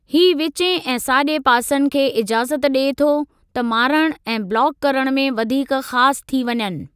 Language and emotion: Sindhi, neutral